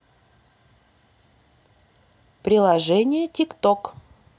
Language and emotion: Russian, neutral